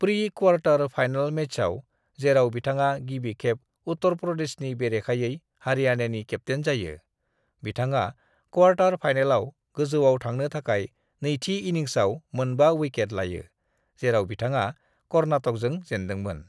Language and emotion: Bodo, neutral